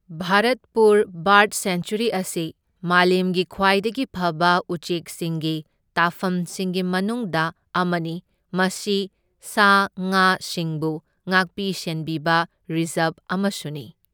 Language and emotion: Manipuri, neutral